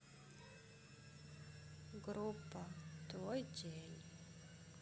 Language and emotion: Russian, sad